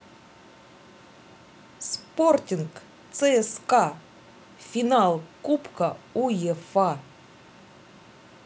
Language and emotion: Russian, positive